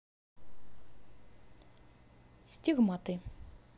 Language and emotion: Russian, neutral